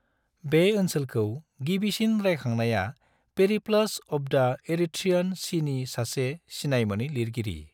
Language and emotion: Bodo, neutral